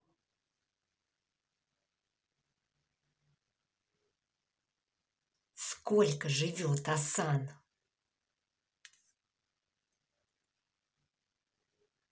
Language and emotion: Russian, angry